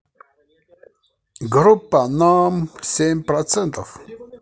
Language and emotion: Russian, positive